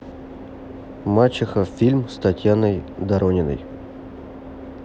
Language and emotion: Russian, neutral